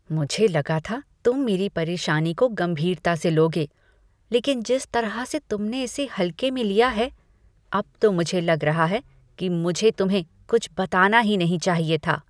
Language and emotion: Hindi, disgusted